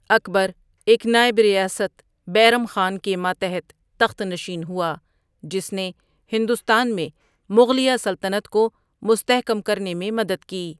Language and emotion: Urdu, neutral